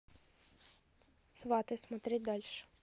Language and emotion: Russian, neutral